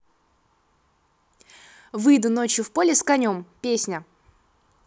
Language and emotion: Russian, neutral